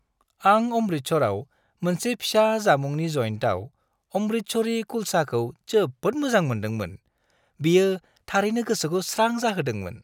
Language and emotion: Bodo, happy